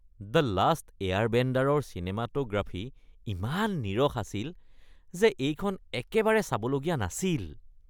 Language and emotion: Assamese, disgusted